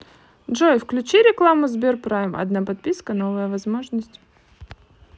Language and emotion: Russian, positive